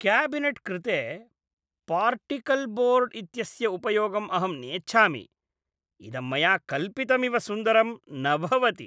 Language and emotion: Sanskrit, disgusted